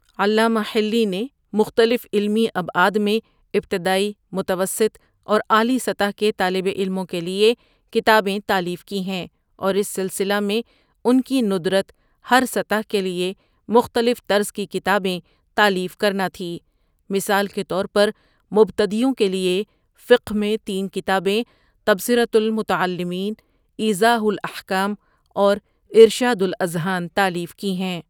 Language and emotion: Urdu, neutral